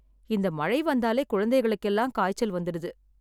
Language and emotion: Tamil, sad